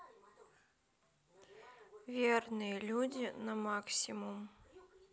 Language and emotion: Russian, sad